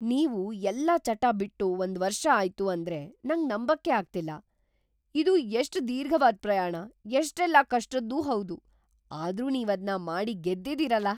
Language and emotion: Kannada, surprised